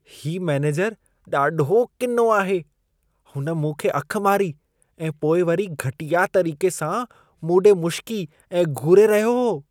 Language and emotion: Sindhi, disgusted